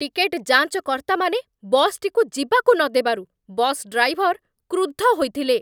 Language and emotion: Odia, angry